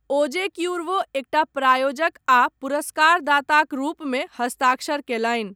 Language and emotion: Maithili, neutral